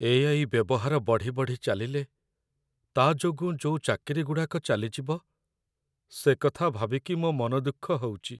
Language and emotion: Odia, sad